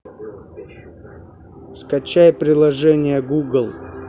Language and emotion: Russian, neutral